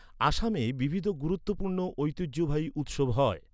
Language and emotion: Bengali, neutral